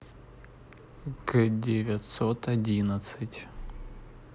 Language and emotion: Russian, neutral